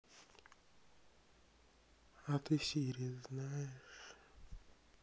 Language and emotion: Russian, sad